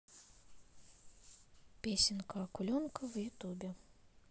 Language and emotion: Russian, neutral